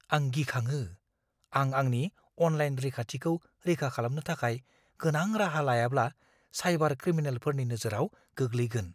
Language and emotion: Bodo, fearful